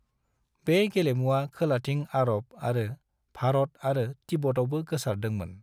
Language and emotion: Bodo, neutral